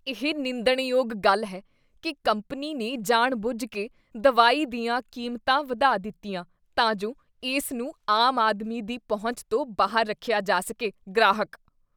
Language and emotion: Punjabi, disgusted